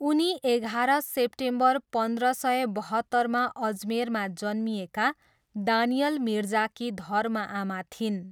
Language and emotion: Nepali, neutral